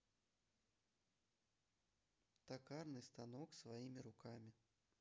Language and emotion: Russian, neutral